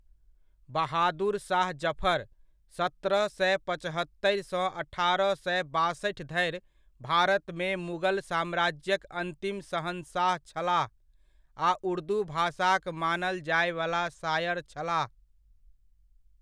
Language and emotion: Maithili, neutral